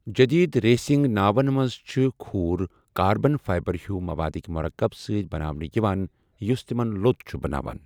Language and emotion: Kashmiri, neutral